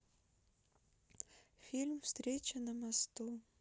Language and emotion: Russian, sad